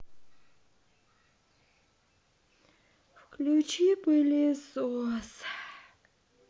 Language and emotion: Russian, sad